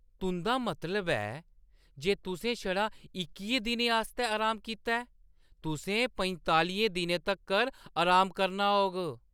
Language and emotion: Dogri, surprised